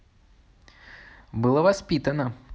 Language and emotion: Russian, neutral